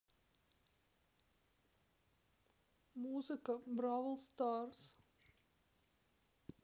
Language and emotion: Russian, sad